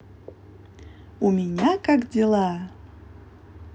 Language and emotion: Russian, positive